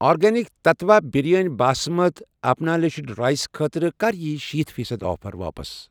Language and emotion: Kashmiri, neutral